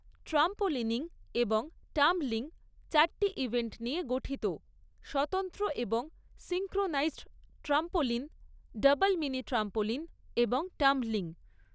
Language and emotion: Bengali, neutral